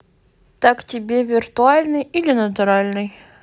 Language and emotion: Russian, neutral